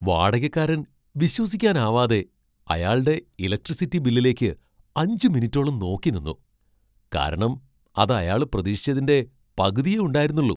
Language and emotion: Malayalam, surprised